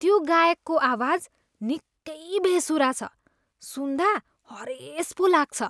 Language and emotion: Nepali, disgusted